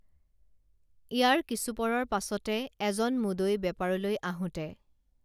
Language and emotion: Assamese, neutral